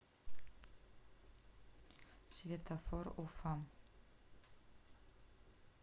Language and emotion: Russian, neutral